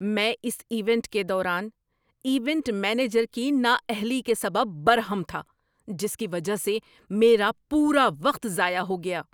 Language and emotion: Urdu, angry